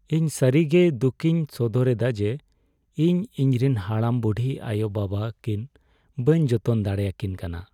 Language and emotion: Santali, sad